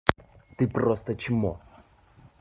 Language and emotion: Russian, angry